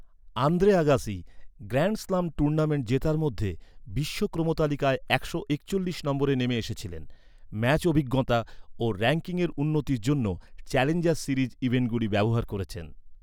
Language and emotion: Bengali, neutral